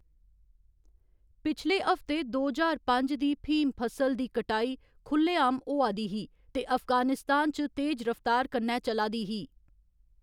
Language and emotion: Dogri, neutral